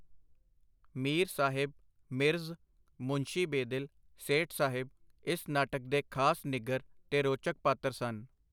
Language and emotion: Punjabi, neutral